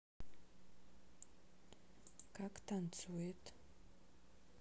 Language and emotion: Russian, neutral